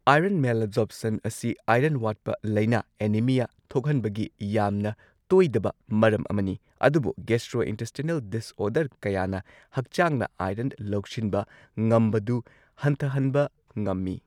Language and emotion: Manipuri, neutral